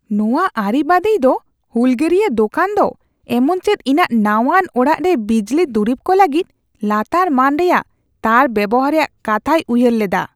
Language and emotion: Santali, disgusted